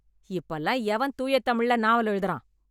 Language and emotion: Tamil, angry